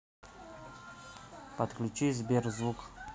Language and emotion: Russian, neutral